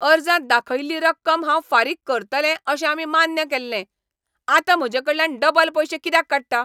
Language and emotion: Goan Konkani, angry